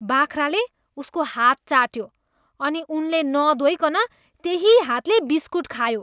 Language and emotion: Nepali, disgusted